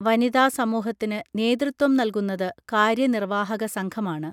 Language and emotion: Malayalam, neutral